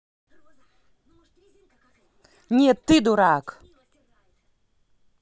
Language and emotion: Russian, angry